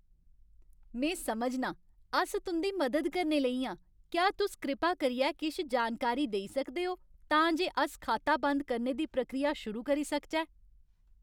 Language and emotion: Dogri, happy